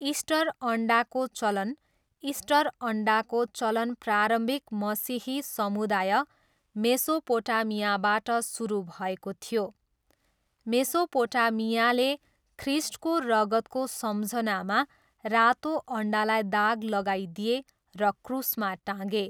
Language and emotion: Nepali, neutral